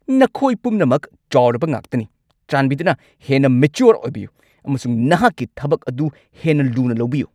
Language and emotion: Manipuri, angry